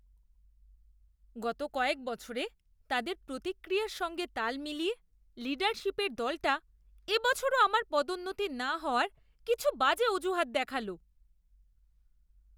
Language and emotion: Bengali, disgusted